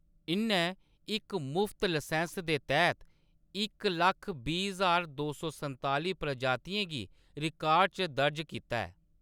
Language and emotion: Dogri, neutral